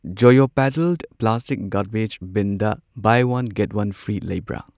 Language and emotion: Manipuri, neutral